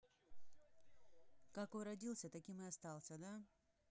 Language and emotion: Russian, neutral